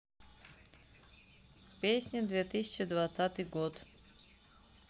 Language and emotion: Russian, neutral